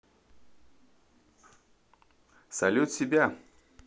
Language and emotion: Russian, neutral